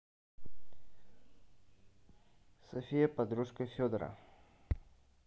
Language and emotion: Russian, neutral